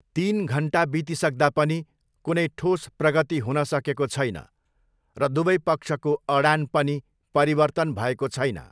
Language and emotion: Nepali, neutral